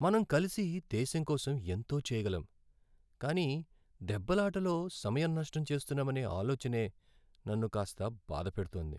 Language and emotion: Telugu, sad